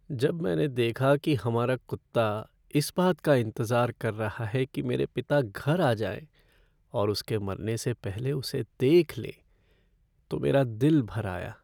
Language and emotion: Hindi, sad